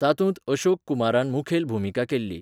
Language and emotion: Goan Konkani, neutral